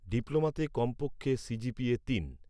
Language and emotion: Bengali, neutral